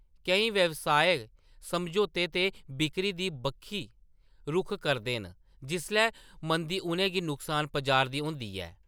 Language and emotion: Dogri, neutral